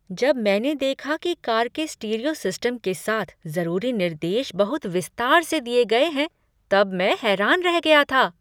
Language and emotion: Hindi, surprised